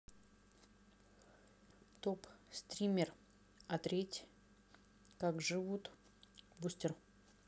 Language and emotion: Russian, neutral